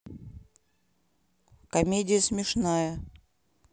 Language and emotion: Russian, neutral